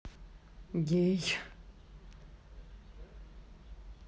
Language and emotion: Russian, neutral